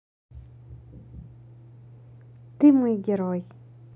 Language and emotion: Russian, positive